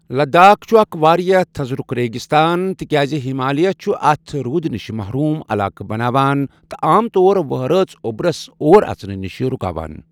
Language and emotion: Kashmiri, neutral